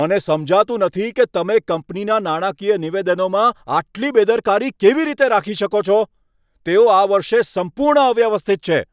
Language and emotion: Gujarati, angry